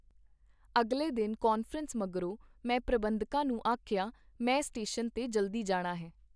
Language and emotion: Punjabi, neutral